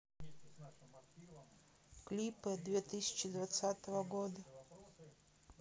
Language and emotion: Russian, neutral